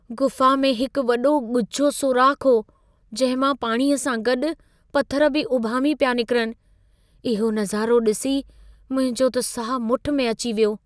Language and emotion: Sindhi, fearful